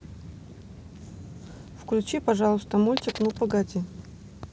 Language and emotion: Russian, neutral